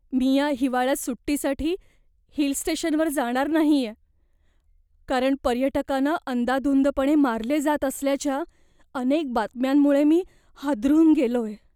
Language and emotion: Marathi, fearful